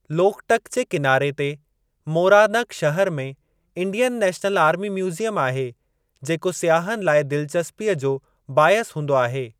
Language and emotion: Sindhi, neutral